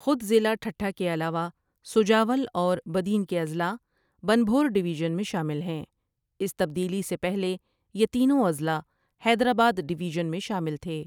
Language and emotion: Urdu, neutral